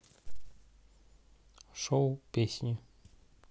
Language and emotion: Russian, neutral